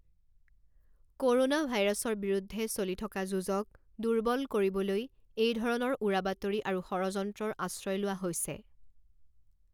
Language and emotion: Assamese, neutral